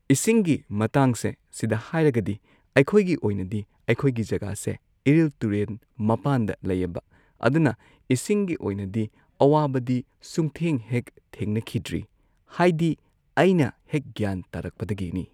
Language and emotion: Manipuri, neutral